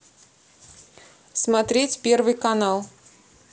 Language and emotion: Russian, neutral